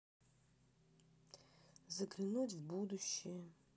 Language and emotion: Russian, sad